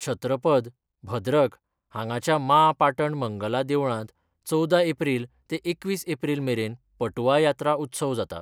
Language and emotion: Goan Konkani, neutral